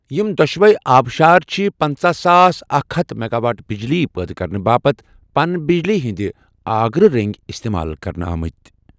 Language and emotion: Kashmiri, neutral